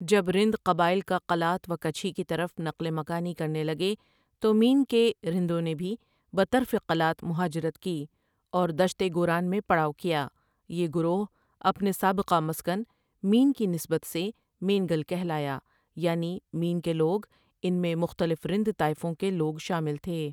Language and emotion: Urdu, neutral